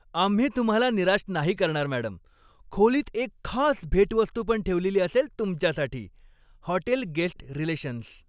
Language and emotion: Marathi, happy